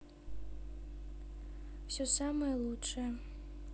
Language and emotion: Russian, neutral